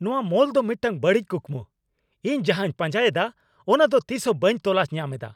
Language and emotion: Santali, angry